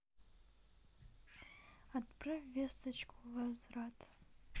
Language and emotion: Russian, neutral